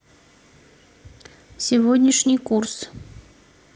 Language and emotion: Russian, neutral